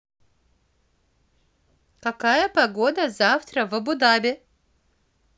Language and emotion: Russian, positive